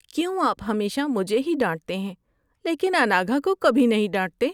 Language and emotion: Urdu, sad